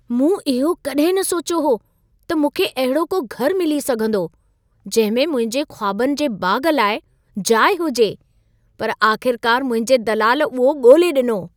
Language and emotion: Sindhi, surprised